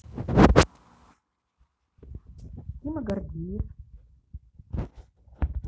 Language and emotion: Russian, neutral